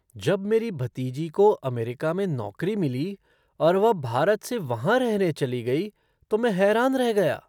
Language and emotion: Hindi, surprised